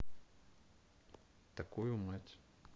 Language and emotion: Russian, neutral